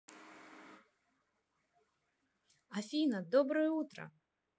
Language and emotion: Russian, positive